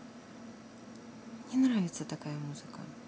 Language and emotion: Russian, neutral